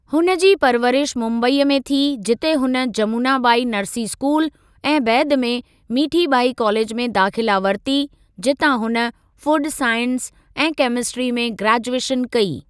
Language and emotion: Sindhi, neutral